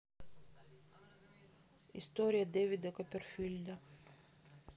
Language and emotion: Russian, neutral